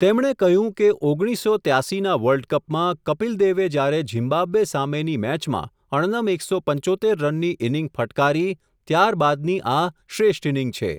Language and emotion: Gujarati, neutral